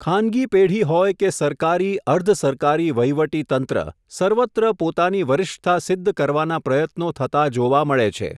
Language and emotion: Gujarati, neutral